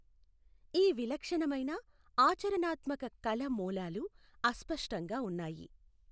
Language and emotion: Telugu, neutral